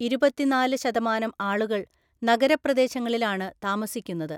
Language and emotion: Malayalam, neutral